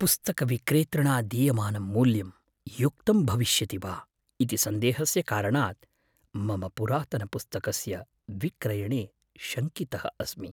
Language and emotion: Sanskrit, fearful